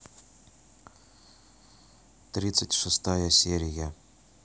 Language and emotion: Russian, neutral